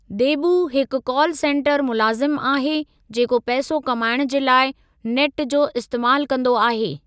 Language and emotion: Sindhi, neutral